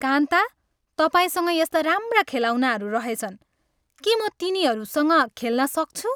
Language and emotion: Nepali, happy